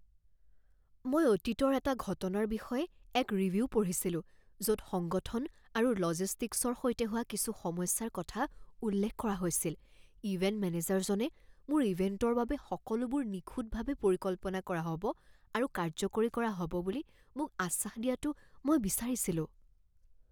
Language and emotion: Assamese, fearful